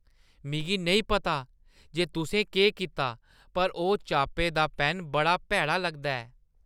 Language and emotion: Dogri, disgusted